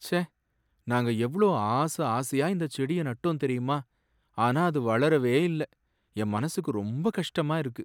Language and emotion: Tamil, sad